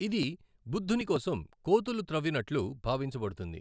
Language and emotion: Telugu, neutral